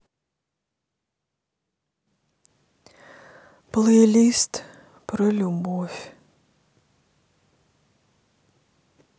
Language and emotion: Russian, sad